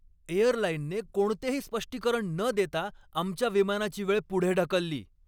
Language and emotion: Marathi, angry